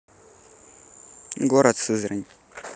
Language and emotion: Russian, neutral